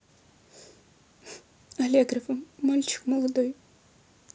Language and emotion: Russian, sad